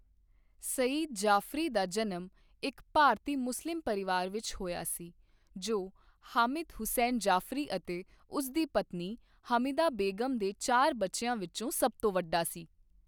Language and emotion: Punjabi, neutral